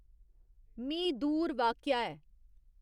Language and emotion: Dogri, neutral